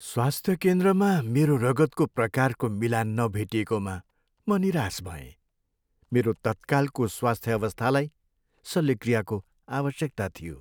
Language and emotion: Nepali, sad